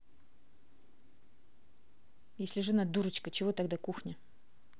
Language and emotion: Russian, angry